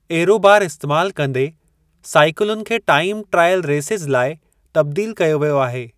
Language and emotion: Sindhi, neutral